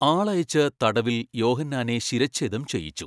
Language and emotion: Malayalam, neutral